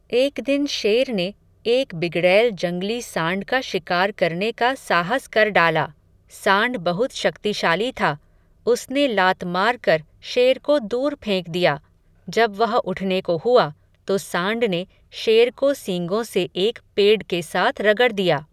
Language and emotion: Hindi, neutral